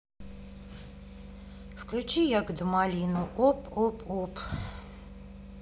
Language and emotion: Russian, neutral